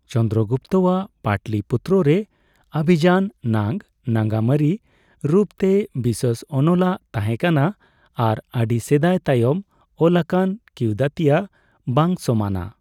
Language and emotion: Santali, neutral